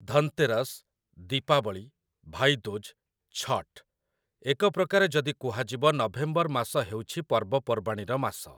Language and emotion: Odia, neutral